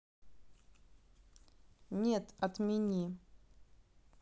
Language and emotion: Russian, neutral